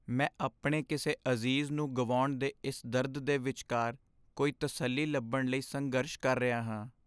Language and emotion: Punjabi, sad